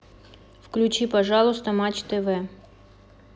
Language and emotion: Russian, neutral